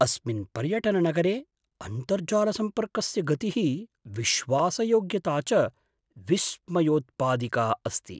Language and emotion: Sanskrit, surprised